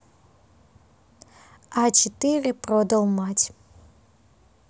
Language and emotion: Russian, neutral